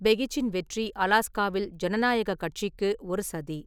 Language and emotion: Tamil, neutral